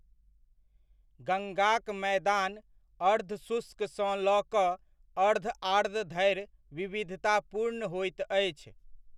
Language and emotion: Maithili, neutral